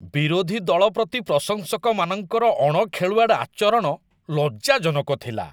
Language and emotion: Odia, disgusted